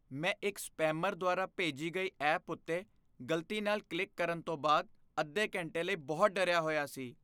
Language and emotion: Punjabi, fearful